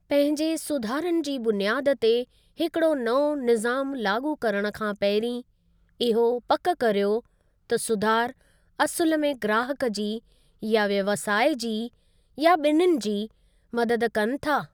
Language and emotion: Sindhi, neutral